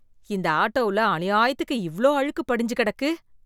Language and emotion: Tamil, disgusted